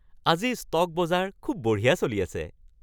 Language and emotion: Assamese, happy